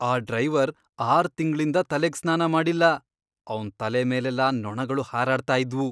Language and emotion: Kannada, disgusted